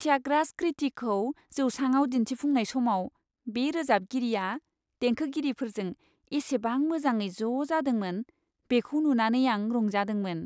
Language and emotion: Bodo, happy